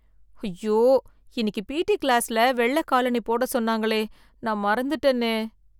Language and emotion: Tamil, fearful